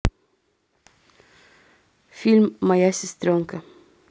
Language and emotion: Russian, neutral